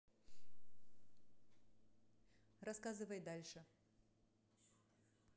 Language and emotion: Russian, neutral